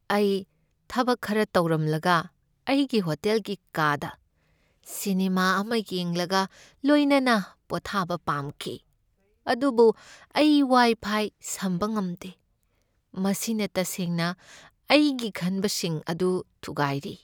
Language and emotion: Manipuri, sad